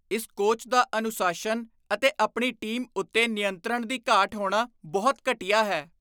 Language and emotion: Punjabi, disgusted